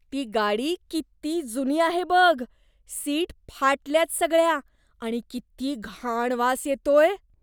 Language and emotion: Marathi, disgusted